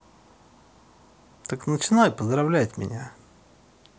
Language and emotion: Russian, neutral